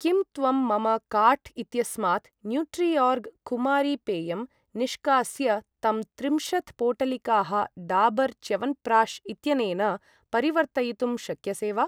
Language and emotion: Sanskrit, neutral